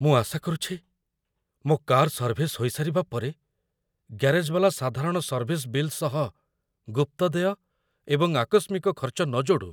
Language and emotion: Odia, fearful